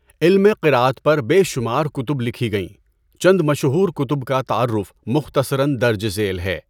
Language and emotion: Urdu, neutral